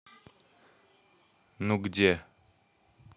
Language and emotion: Russian, neutral